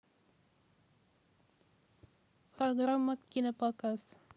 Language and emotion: Russian, neutral